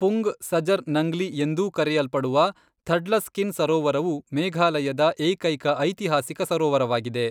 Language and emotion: Kannada, neutral